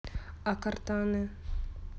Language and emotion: Russian, neutral